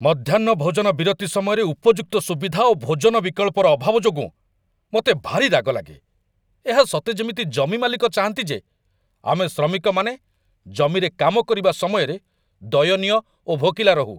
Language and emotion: Odia, angry